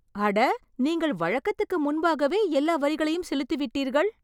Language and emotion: Tamil, surprised